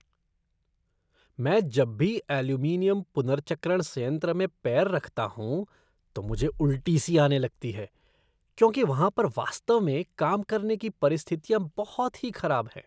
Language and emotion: Hindi, disgusted